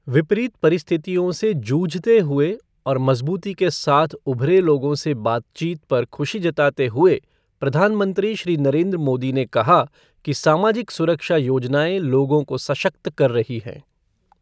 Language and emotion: Hindi, neutral